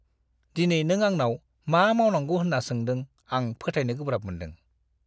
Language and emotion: Bodo, disgusted